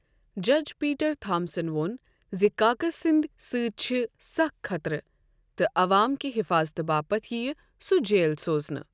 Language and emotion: Kashmiri, neutral